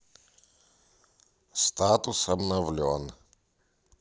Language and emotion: Russian, neutral